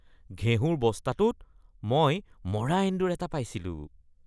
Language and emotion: Assamese, disgusted